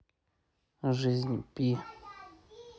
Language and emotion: Russian, neutral